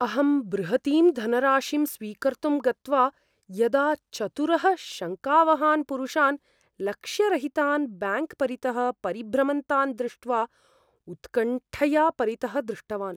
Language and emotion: Sanskrit, fearful